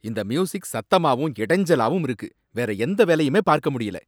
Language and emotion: Tamil, angry